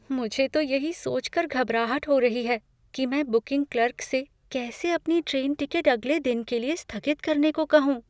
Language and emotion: Hindi, fearful